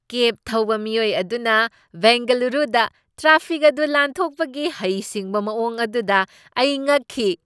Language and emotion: Manipuri, surprised